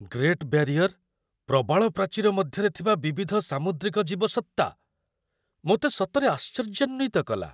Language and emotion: Odia, surprised